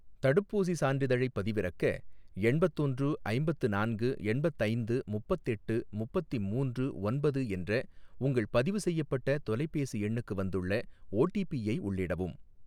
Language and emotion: Tamil, neutral